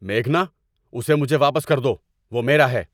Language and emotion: Urdu, angry